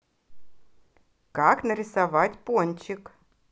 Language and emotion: Russian, positive